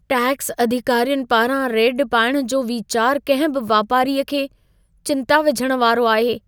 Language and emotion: Sindhi, fearful